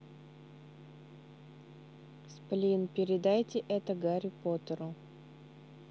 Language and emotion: Russian, neutral